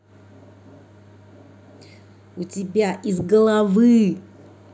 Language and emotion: Russian, angry